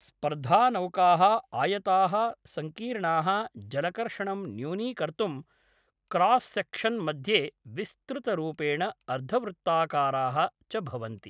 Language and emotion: Sanskrit, neutral